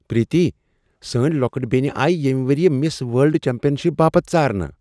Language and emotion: Kashmiri, surprised